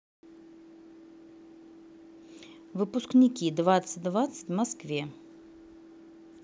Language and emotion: Russian, neutral